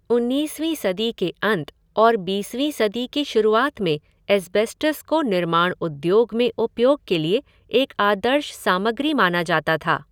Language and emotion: Hindi, neutral